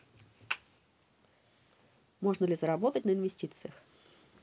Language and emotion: Russian, neutral